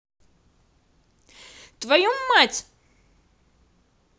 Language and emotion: Russian, angry